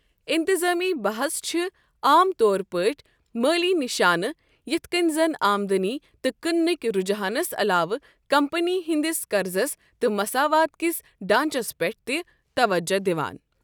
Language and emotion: Kashmiri, neutral